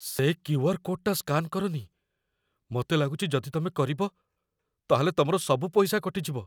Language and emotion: Odia, fearful